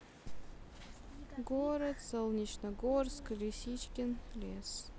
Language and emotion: Russian, neutral